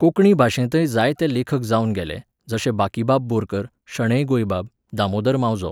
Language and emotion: Goan Konkani, neutral